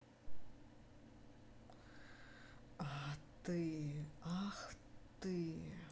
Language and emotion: Russian, angry